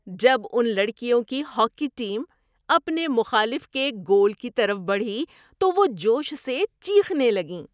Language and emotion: Urdu, happy